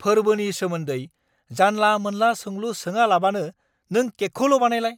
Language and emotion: Bodo, angry